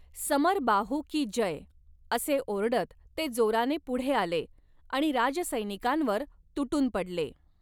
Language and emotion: Marathi, neutral